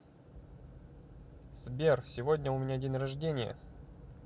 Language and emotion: Russian, neutral